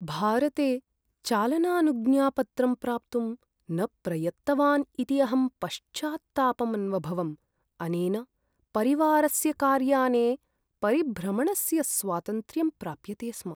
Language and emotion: Sanskrit, sad